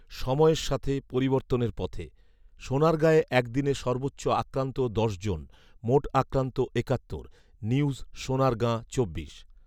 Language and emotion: Bengali, neutral